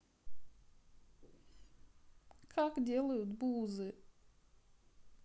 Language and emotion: Russian, sad